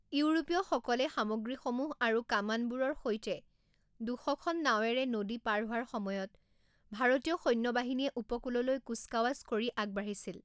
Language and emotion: Assamese, neutral